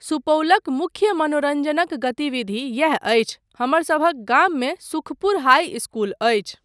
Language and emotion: Maithili, neutral